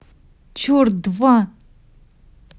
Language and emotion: Russian, angry